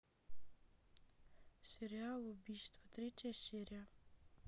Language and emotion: Russian, neutral